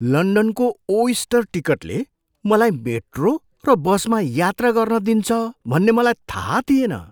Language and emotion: Nepali, surprised